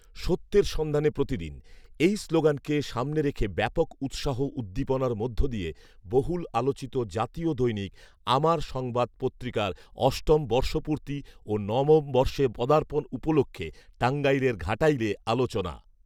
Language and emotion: Bengali, neutral